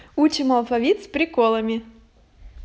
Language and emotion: Russian, positive